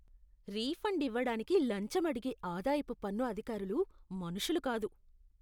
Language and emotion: Telugu, disgusted